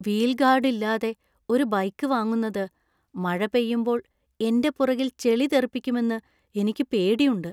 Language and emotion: Malayalam, fearful